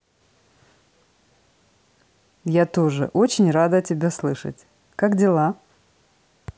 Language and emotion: Russian, positive